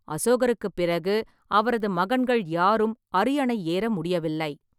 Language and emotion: Tamil, neutral